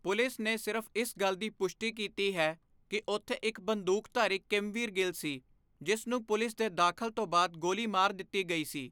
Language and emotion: Punjabi, neutral